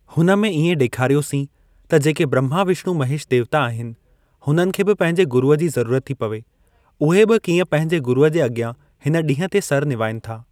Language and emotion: Sindhi, neutral